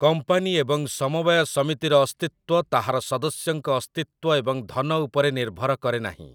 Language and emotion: Odia, neutral